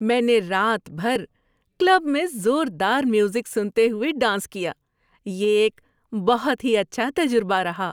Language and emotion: Urdu, happy